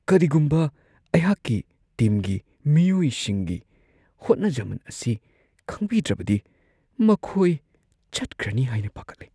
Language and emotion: Manipuri, fearful